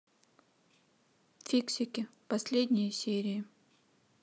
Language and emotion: Russian, neutral